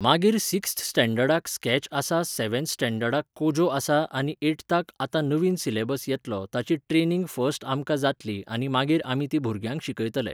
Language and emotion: Goan Konkani, neutral